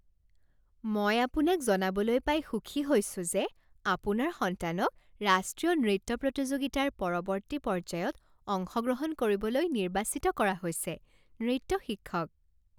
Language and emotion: Assamese, happy